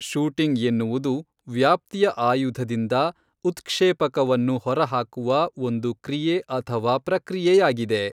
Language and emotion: Kannada, neutral